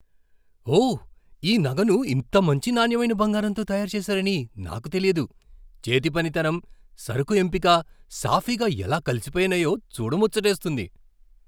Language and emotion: Telugu, surprised